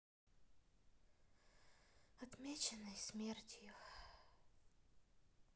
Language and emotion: Russian, sad